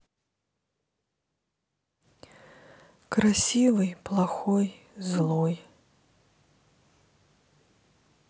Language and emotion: Russian, sad